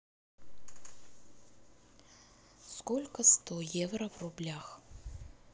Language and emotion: Russian, neutral